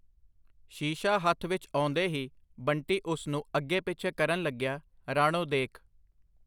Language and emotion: Punjabi, neutral